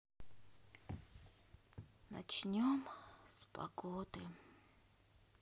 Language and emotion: Russian, sad